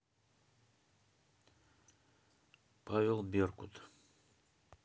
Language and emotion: Russian, neutral